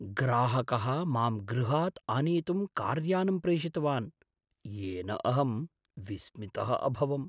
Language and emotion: Sanskrit, surprised